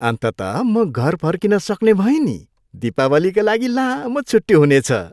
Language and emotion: Nepali, happy